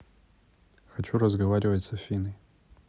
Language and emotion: Russian, neutral